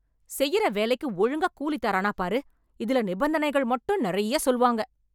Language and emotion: Tamil, angry